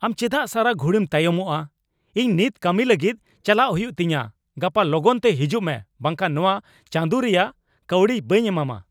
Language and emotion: Santali, angry